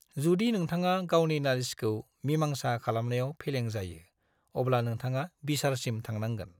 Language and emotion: Bodo, neutral